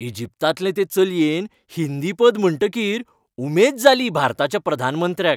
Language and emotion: Goan Konkani, happy